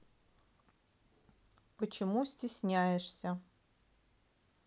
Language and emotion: Russian, neutral